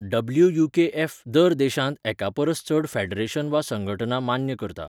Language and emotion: Goan Konkani, neutral